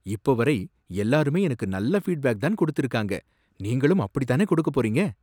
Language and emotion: Tamil, surprised